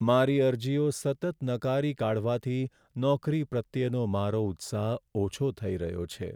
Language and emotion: Gujarati, sad